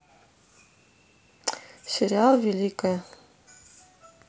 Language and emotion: Russian, neutral